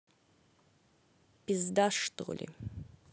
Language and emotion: Russian, angry